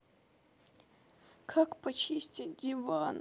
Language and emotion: Russian, sad